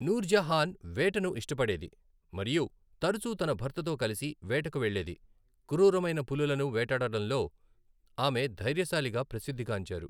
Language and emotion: Telugu, neutral